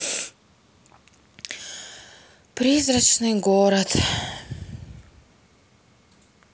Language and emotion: Russian, sad